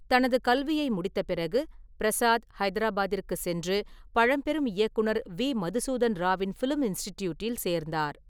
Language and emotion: Tamil, neutral